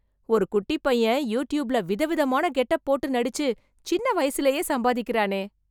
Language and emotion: Tamil, surprised